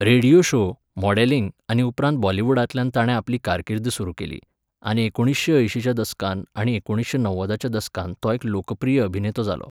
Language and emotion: Goan Konkani, neutral